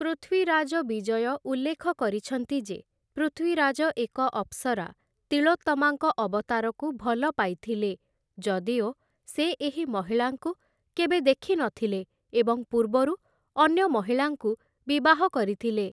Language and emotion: Odia, neutral